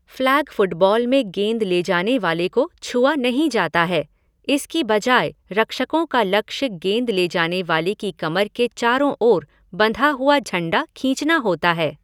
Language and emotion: Hindi, neutral